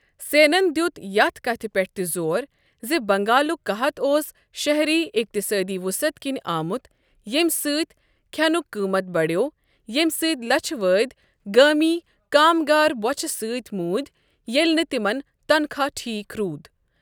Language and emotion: Kashmiri, neutral